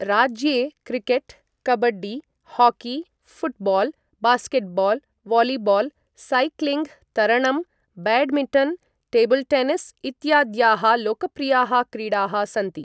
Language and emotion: Sanskrit, neutral